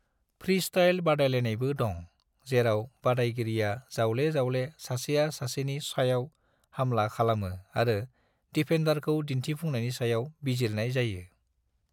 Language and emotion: Bodo, neutral